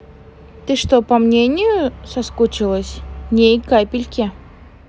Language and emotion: Russian, neutral